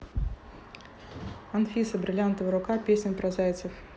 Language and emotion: Russian, neutral